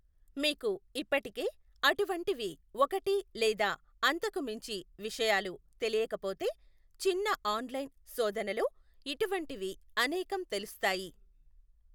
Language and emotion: Telugu, neutral